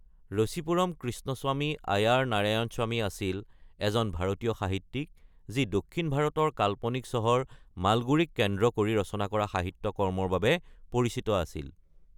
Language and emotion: Assamese, neutral